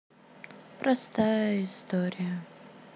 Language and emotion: Russian, sad